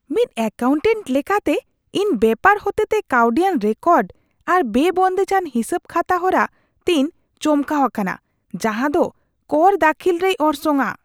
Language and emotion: Santali, disgusted